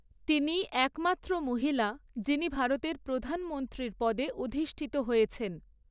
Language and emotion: Bengali, neutral